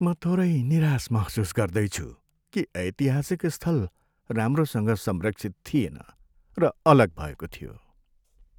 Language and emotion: Nepali, sad